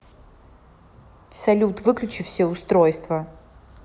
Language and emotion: Russian, angry